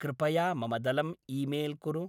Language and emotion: Sanskrit, neutral